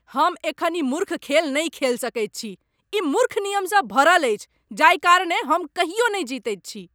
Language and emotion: Maithili, angry